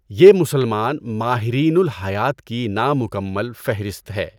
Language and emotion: Urdu, neutral